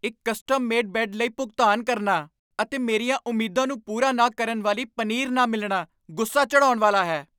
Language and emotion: Punjabi, angry